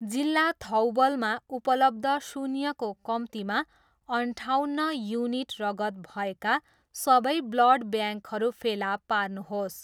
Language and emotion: Nepali, neutral